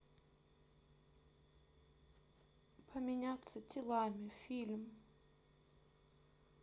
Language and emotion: Russian, sad